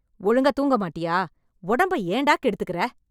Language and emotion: Tamil, angry